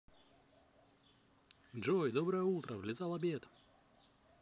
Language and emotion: Russian, positive